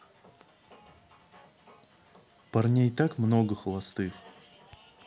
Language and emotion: Russian, neutral